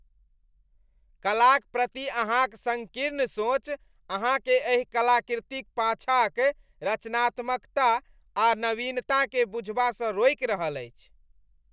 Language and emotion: Maithili, disgusted